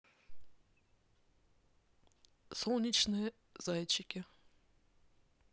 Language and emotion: Russian, neutral